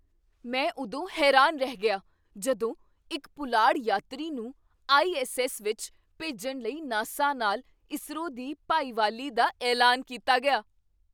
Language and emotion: Punjabi, surprised